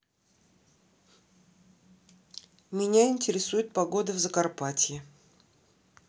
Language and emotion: Russian, neutral